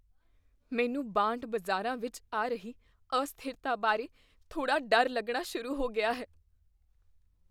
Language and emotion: Punjabi, fearful